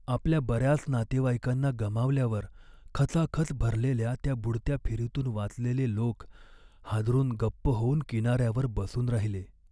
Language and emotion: Marathi, sad